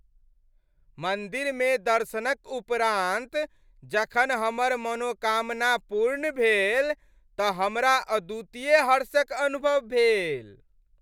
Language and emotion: Maithili, happy